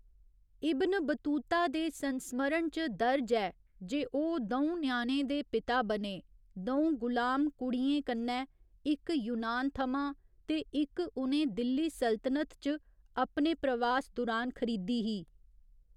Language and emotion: Dogri, neutral